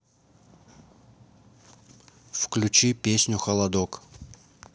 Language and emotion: Russian, neutral